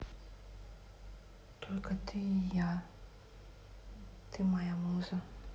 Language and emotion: Russian, neutral